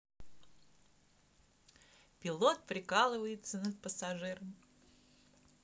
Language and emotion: Russian, positive